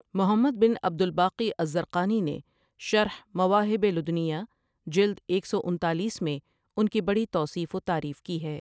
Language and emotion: Urdu, neutral